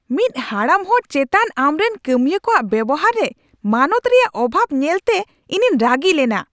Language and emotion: Santali, angry